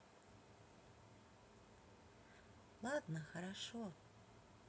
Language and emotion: Russian, positive